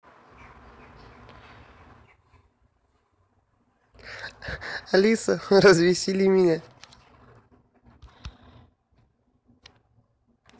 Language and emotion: Russian, positive